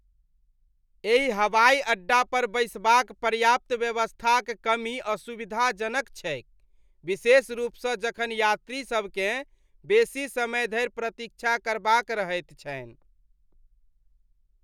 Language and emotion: Maithili, disgusted